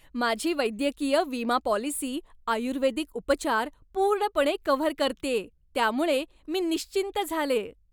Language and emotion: Marathi, happy